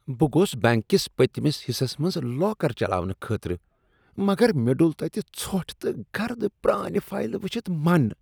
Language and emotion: Kashmiri, disgusted